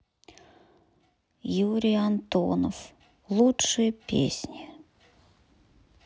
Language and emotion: Russian, sad